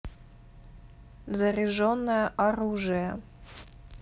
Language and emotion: Russian, neutral